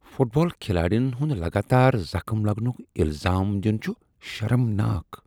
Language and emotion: Kashmiri, disgusted